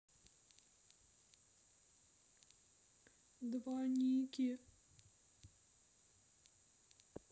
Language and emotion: Russian, sad